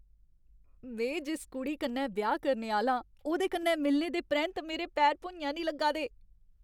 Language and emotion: Dogri, happy